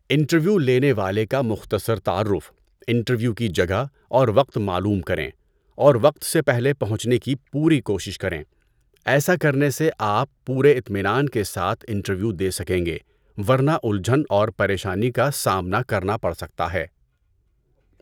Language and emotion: Urdu, neutral